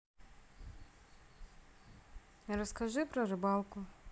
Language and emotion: Russian, neutral